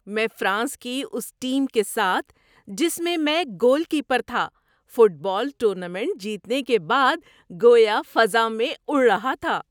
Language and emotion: Urdu, happy